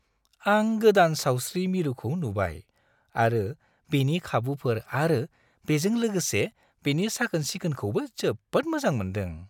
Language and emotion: Bodo, happy